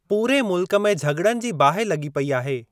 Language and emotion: Sindhi, neutral